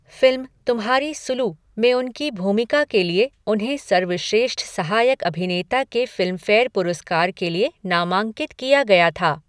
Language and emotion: Hindi, neutral